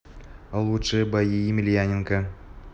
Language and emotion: Russian, neutral